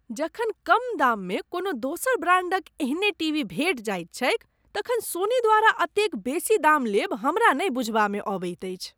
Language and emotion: Maithili, disgusted